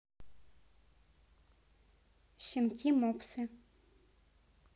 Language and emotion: Russian, neutral